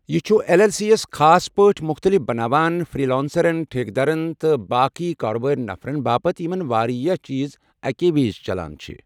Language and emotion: Kashmiri, neutral